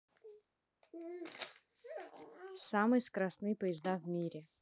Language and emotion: Russian, neutral